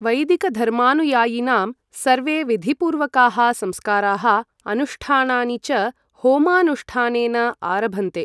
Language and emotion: Sanskrit, neutral